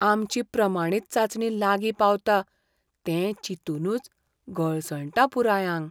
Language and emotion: Goan Konkani, fearful